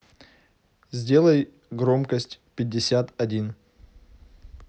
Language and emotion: Russian, neutral